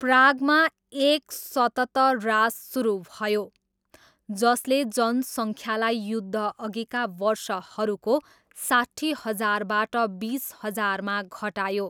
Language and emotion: Nepali, neutral